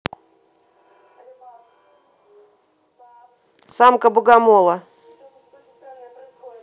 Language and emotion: Russian, neutral